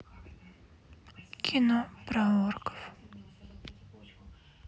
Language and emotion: Russian, sad